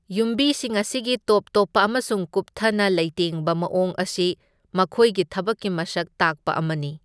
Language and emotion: Manipuri, neutral